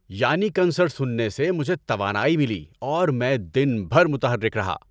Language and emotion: Urdu, happy